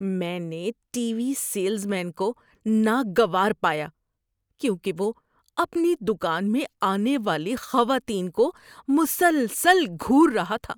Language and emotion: Urdu, disgusted